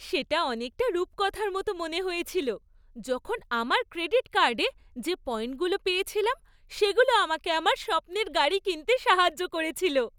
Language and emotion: Bengali, happy